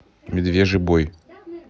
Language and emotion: Russian, neutral